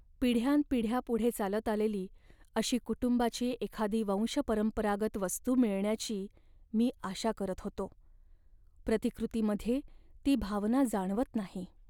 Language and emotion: Marathi, sad